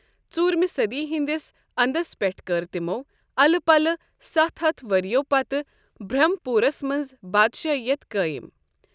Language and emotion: Kashmiri, neutral